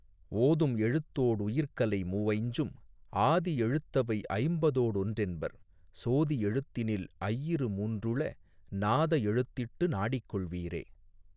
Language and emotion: Tamil, neutral